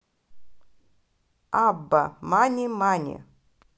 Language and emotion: Russian, positive